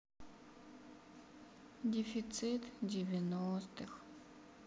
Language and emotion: Russian, sad